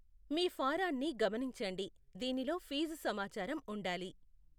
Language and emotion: Telugu, neutral